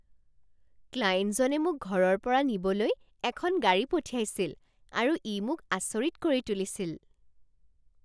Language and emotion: Assamese, surprised